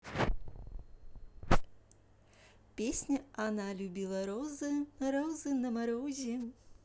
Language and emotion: Russian, positive